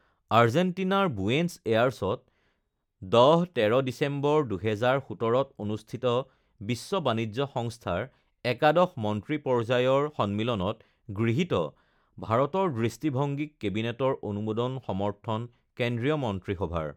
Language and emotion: Assamese, neutral